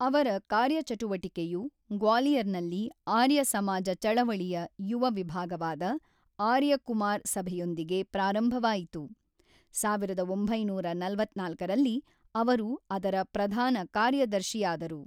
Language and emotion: Kannada, neutral